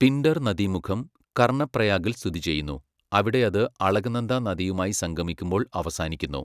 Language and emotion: Malayalam, neutral